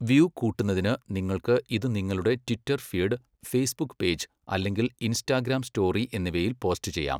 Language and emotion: Malayalam, neutral